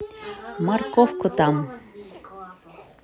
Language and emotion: Russian, neutral